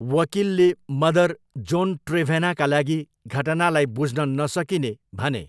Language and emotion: Nepali, neutral